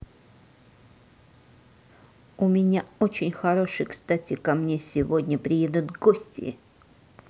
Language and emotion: Russian, angry